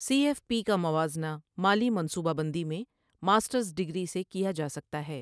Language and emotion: Urdu, neutral